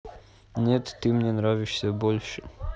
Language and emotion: Russian, neutral